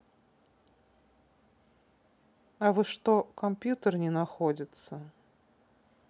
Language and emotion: Russian, neutral